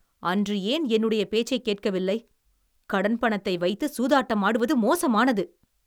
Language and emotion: Tamil, angry